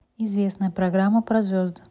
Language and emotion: Russian, neutral